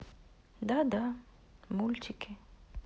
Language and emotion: Russian, sad